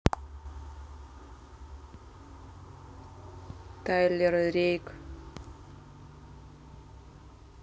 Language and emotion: Russian, neutral